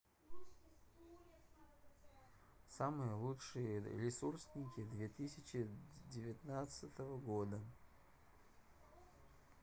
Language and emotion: Russian, neutral